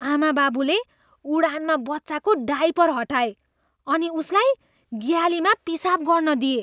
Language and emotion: Nepali, disgusted